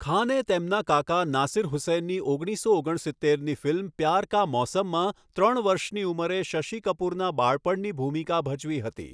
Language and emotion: Gujarati, neutral